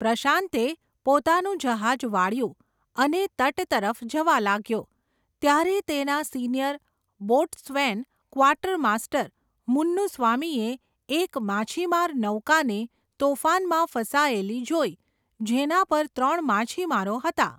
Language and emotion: Gujarati, neutral